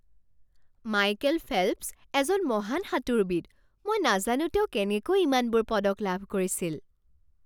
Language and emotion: Assamese, surprised